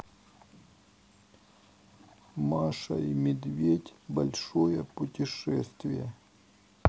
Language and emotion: Russian, sad